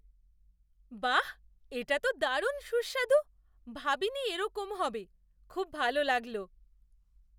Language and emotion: Bengali, surprised